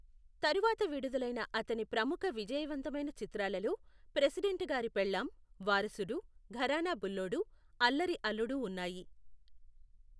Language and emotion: Telugu, neutral